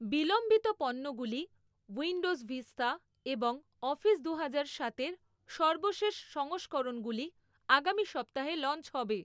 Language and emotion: Bengali, neutral